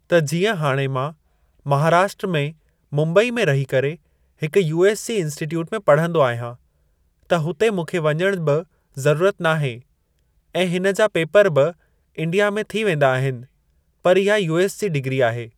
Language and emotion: Sindhi, neutral